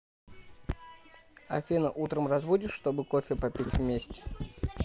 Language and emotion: Russian, neutral